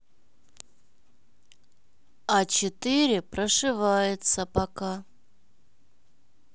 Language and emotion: Russian, neutral